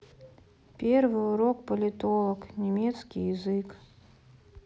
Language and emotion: Russian, sad